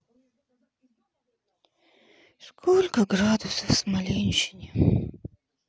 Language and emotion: Russian, sad